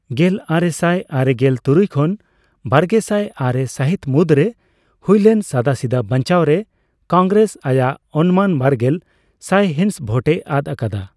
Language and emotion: Santali, neutral